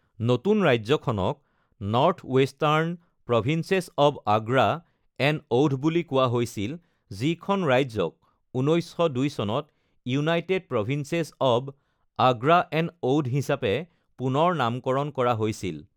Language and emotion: Assamese, neutral